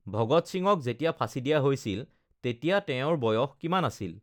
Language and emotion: Assamese, neutral